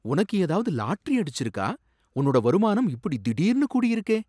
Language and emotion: Tamil, surprised